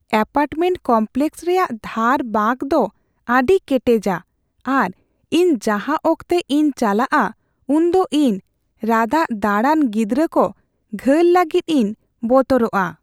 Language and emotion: Santali, fearful